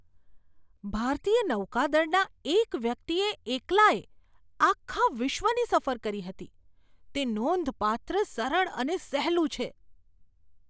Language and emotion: Gujarati, surprised